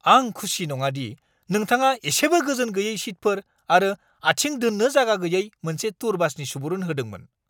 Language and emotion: Bodo, angry